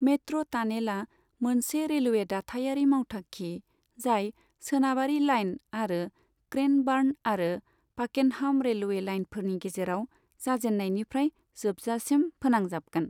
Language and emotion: Bodo, neutral